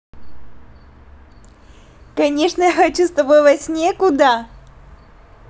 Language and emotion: Russian, positive